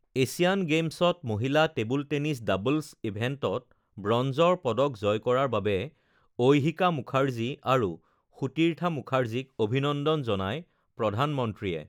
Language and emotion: Assamese, neutral